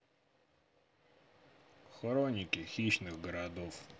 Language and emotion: Russian, neutral